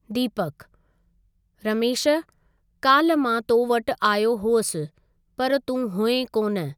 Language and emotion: Sindhi, neutral